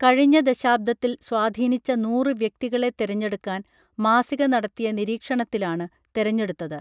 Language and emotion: Malayalam, neutral